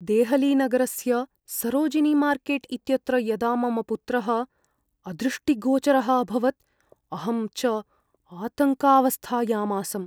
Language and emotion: Sanskrit, fearful